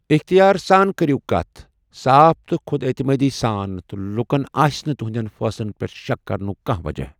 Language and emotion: Kashmiri, neutral